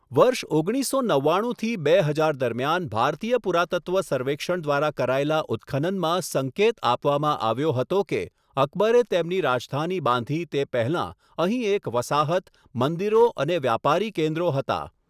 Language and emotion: Gujarati, neutral